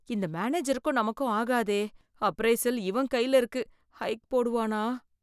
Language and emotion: Tamil, fearful